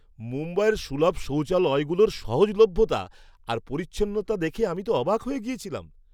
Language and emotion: Bengali, surprised